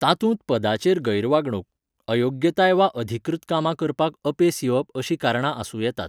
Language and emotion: Goan Konkani, neutral